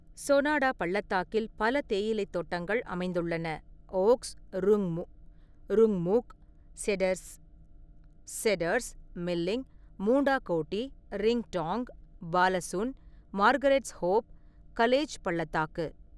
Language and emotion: Tamil, neutral